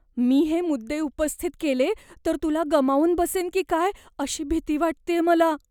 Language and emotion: Marathi, fearful